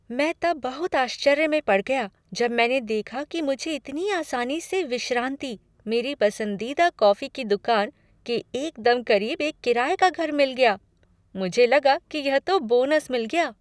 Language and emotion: Hindi, surprised